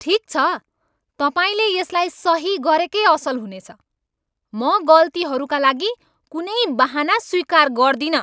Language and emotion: Nepali, angry